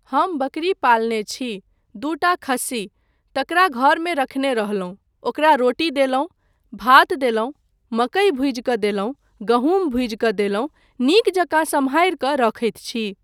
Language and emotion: Maithili, neutral